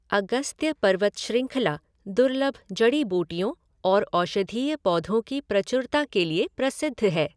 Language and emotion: Hindi, neutral